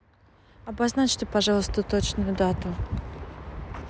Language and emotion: Russian, neutral